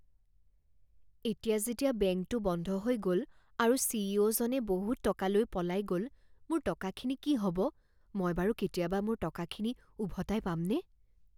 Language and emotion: Assamese, fearful